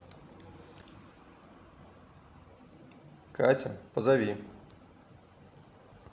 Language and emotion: Russian, neutral